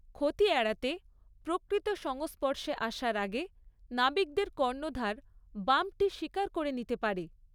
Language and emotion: Bengali, neutral